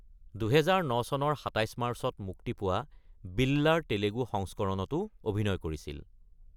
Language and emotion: Assamese, neutral